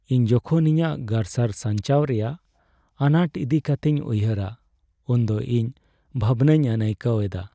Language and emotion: Santali, sad